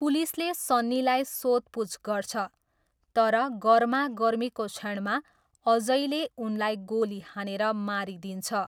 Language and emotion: Nepali, neutral